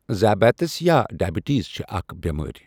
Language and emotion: Kashmiri, neutral